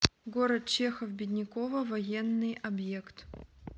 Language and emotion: Russian, neutral